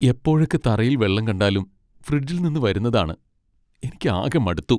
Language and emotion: Malayalam, sad